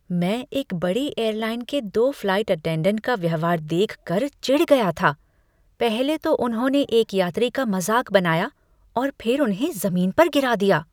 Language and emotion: Hindi, disgusted